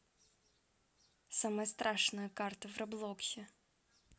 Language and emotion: Russian, neutral